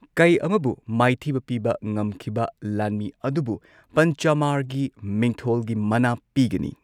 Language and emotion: Manipuri, neutral